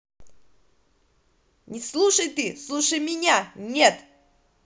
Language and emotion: Russian, angry